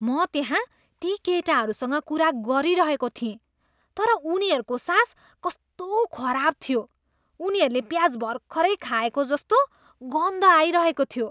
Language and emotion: Nepali, disgusted